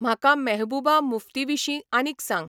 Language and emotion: Goan Konkani, neutral